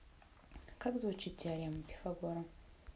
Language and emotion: Russian, neutral